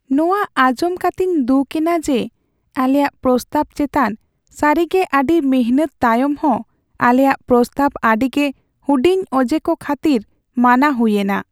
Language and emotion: Santali, sad